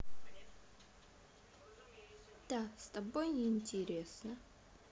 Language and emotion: Russian, sad